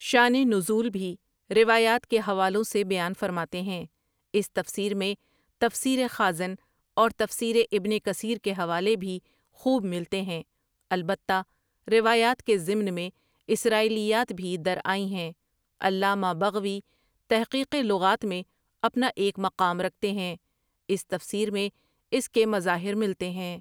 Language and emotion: Urdu, neutral